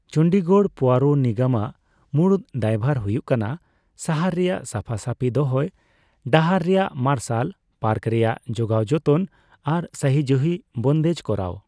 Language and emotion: Santali, neutral